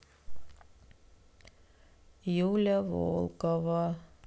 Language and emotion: Russian, sad